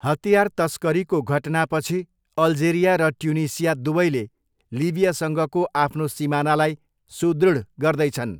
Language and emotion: Nepali, neutral